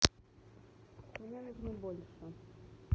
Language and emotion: Russian, neutral